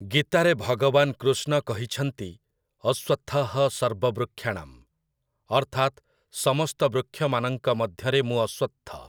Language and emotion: Odia, neutral